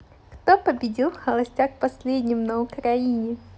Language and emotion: Russian, positive